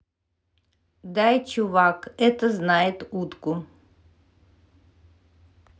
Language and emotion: Russian, neutral